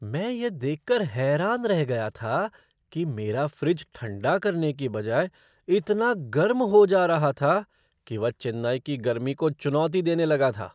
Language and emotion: Hindi, surprised